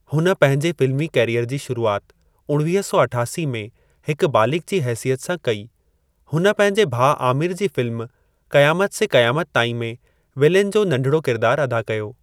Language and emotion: Sindhi, neutral